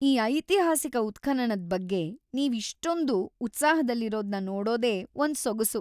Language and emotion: Kannada, happy